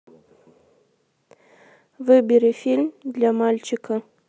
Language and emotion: Russian, neutral